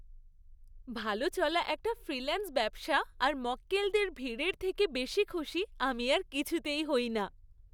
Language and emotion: Bengali, happy